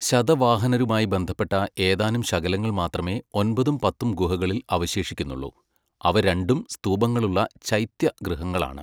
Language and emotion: Malayalam, neutral